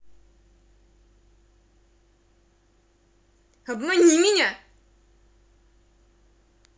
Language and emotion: Russian, angry